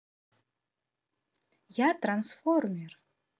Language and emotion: Russian, neutral